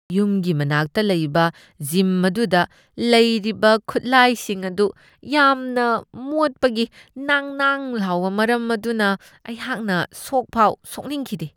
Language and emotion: Manipuri, disgusted